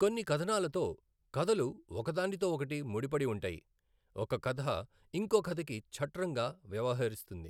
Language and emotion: Telugu, neutral